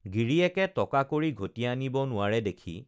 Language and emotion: Assamese, neutral